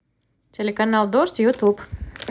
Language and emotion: Russian, positive